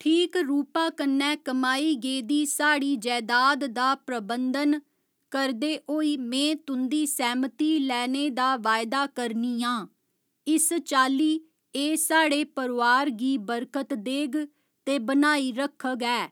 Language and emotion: Dogri, neutral